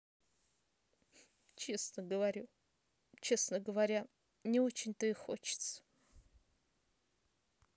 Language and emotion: Russian, sad